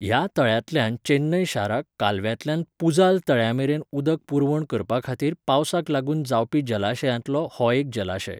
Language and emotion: Goan Konkani, neutral